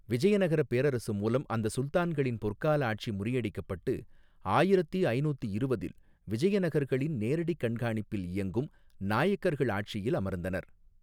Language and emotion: Tamil, neutral